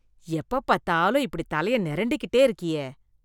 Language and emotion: Tamil, disgusted